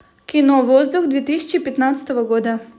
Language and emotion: Russian, positive